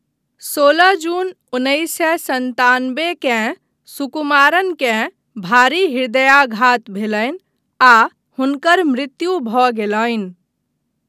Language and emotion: Maithili, neutral